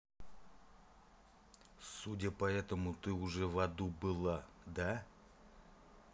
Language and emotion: Russian, angry